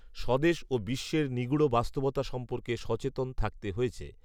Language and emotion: Bengali, neutral